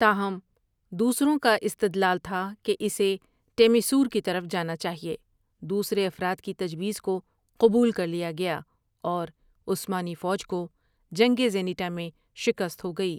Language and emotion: Urdu, neutral